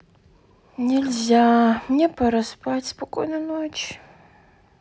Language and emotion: Russian, sad